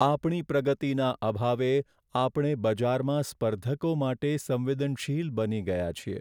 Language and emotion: Gujarati, sad